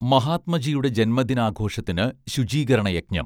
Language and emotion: Malayalam, neutral